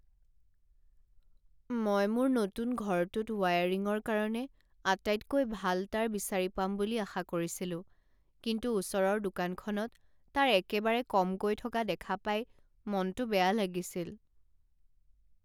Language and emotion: Assamese, sad